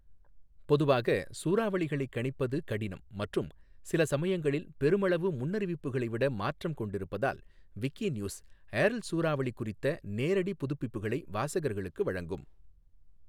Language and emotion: Tamil, neutral